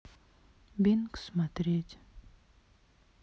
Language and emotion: Russian, sad